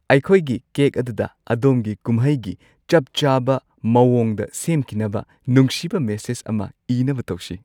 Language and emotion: Manipuri, happy